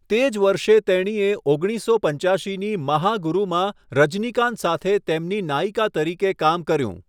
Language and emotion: Gujarati, neutral